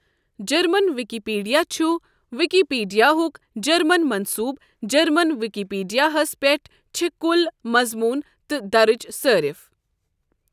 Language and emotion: Kashmiri, neutral